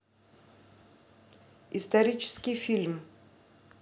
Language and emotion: Russian, neutral